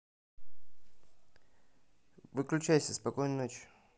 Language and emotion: Russian, neutral